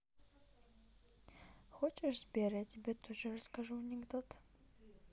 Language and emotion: Russian, neutral